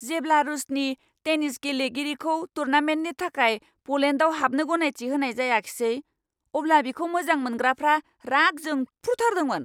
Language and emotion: Bodo, angry